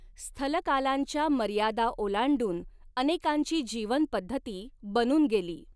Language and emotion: Marathi, neutral